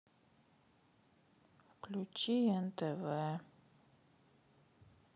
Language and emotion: Russian, sad